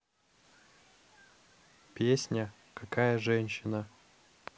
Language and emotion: Russian, neutral